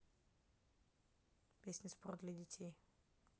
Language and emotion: Russian, neutral